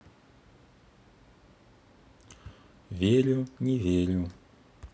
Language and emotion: Russian, neutral